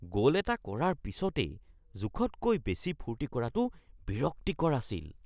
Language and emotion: Assamese, disgusted